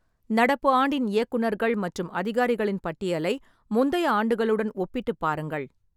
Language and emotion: Tamil, neutral